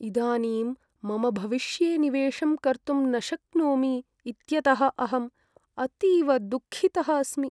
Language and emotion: Sanskrit, sad